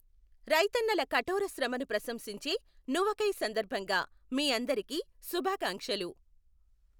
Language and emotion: Telugu, neutral